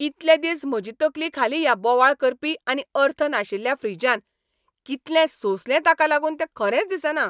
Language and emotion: Goan Konkani, angry